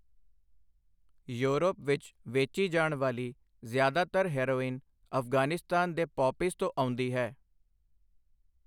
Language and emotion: Punjabi, neutral